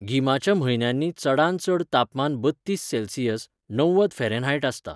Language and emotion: Goan Konkani, neutral